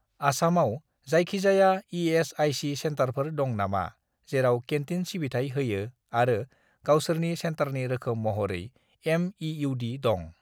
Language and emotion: Bodo, neutral